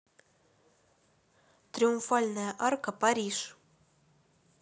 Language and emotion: Russian, neutral